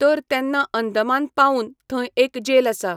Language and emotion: Goan Konkani, neutral